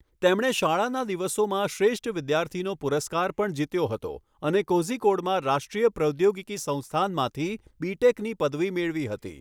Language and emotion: Gujarati, neutral